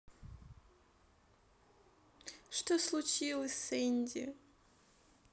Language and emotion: Russian, sad